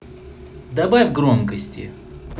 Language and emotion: Russian, positive